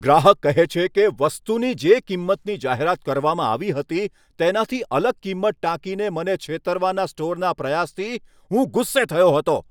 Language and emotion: Gujarati, angry